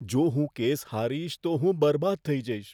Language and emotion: Gujarati, fearful